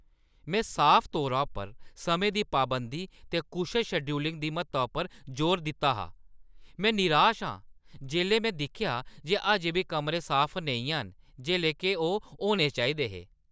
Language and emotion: Dogri, angry